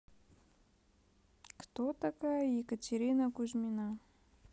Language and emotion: Russian, neutral